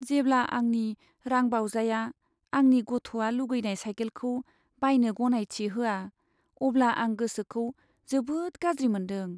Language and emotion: Bodo, sad